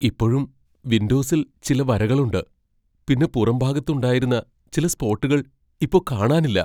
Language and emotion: Malayalam, fearful